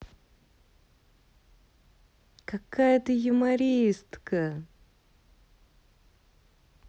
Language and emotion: Russian, positive